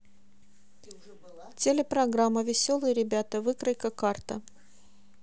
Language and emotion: Russian, neutral